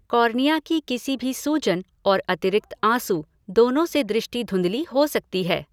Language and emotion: Hindi, neutral